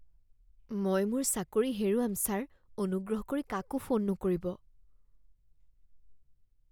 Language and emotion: Assamese, fearful